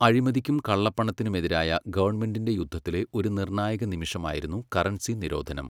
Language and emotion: Malayalam, neutral